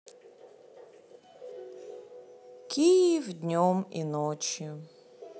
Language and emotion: Russian, sad